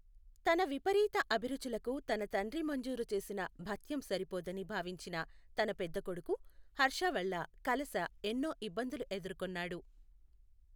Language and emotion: Telugu, neutral